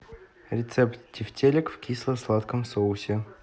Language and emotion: Russian, neutral